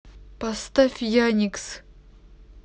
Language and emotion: Russian, neutral